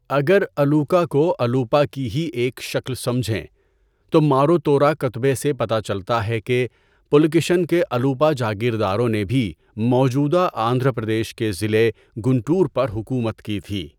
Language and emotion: Urdu, neutral